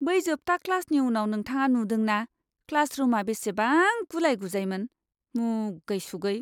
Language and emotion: Bodo, disgusted